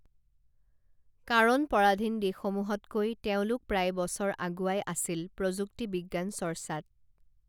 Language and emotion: Assamese, neutral